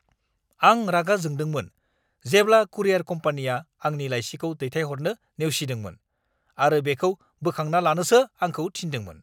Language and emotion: Bodo, angry